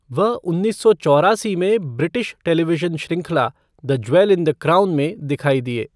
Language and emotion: Hindi, neutral